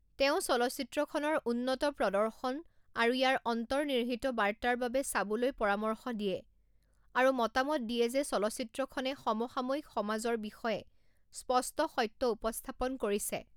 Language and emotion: Assamese, neutral